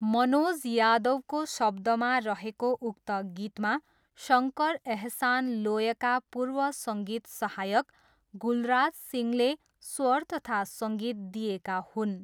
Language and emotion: Nepali, neutral